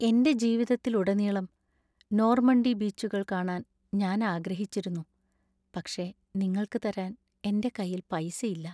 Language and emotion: Malayalam, sad